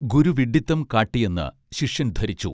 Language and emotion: Malayalam, neutral